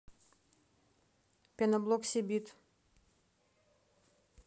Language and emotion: Russian, neutral